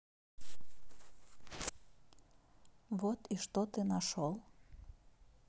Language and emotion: Russian, neutral